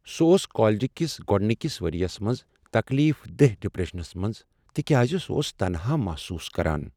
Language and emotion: Kashmiri, sad